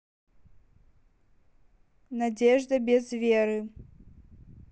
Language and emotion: Russian, neutral